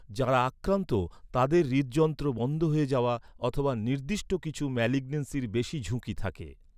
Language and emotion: Bengali, neutral